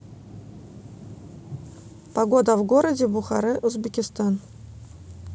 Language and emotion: Russian, neutral